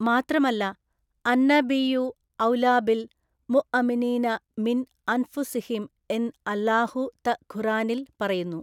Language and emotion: Malayalam, neutral